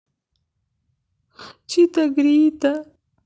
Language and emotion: Russian, sad